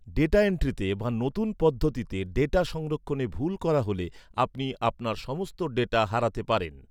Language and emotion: Bengali, neutral